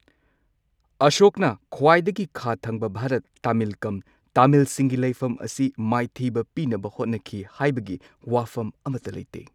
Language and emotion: Manipuri, neutral